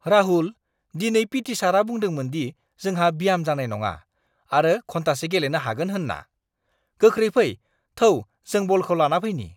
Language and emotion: Bodo, surprised